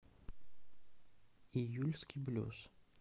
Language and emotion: Russian, neutral